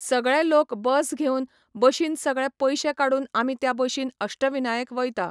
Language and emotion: Goan Konkani, neutral